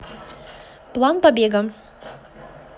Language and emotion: Russian, positive